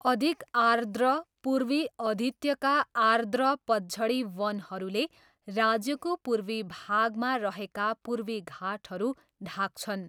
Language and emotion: Nepali, neutral